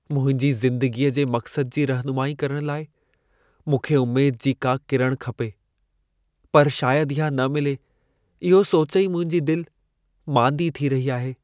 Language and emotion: Sindhi, sad